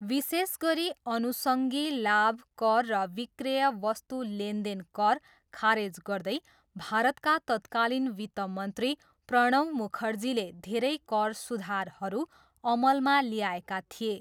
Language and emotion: Nepali, neutral